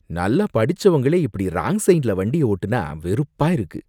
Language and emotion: Tamil, disgusted